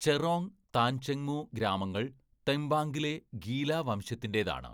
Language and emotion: Malayalam, neutral